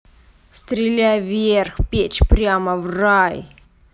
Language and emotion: Russian, angry